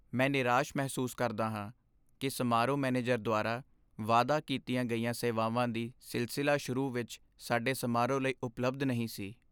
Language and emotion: Punjabi, sad